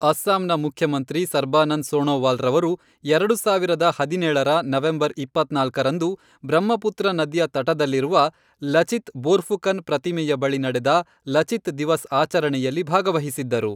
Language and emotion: Kannada, neutral